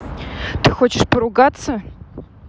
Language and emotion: Russian, angry